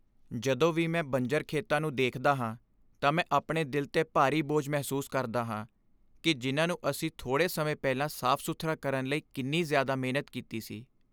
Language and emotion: Punjabi, sad